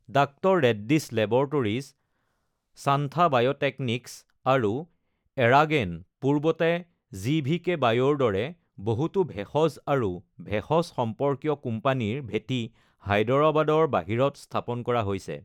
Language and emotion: Assamese, neutral